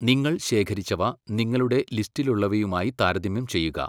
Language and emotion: Malayalam, neutral